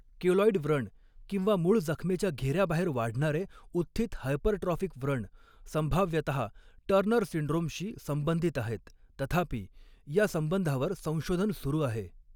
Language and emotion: Marathi, neutral